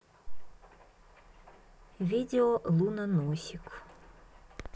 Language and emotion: Russian, neutral